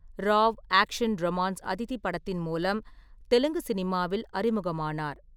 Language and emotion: Tamil, neutral